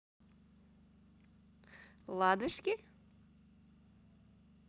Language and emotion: Russian, positive